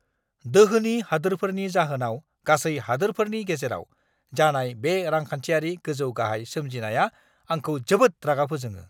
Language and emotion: Bodo, angry